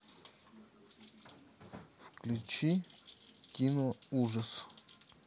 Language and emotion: Russian, neutral